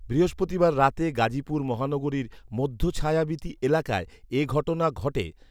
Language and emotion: Bengali, neutral